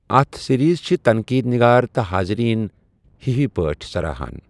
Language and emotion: Kashmiri, neutral